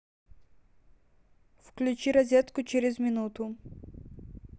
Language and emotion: Russian, neutral